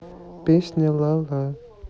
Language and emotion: Russian, neutral